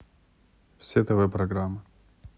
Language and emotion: Russian, neutral